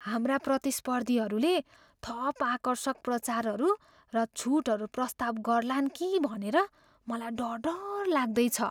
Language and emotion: Nepali, fearful